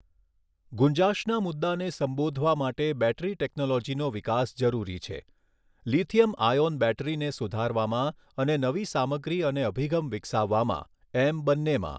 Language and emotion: Gujarati, neutral